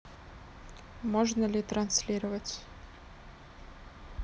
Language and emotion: Russian, neutral